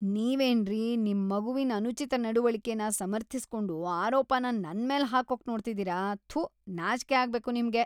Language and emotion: Kannada, disgusted